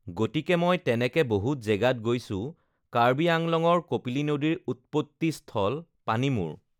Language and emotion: Assamese, neutral